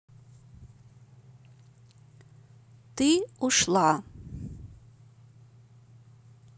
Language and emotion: Russian, neutral